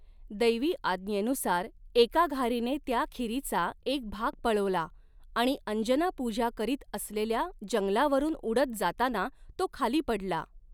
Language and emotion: Marathi, neutral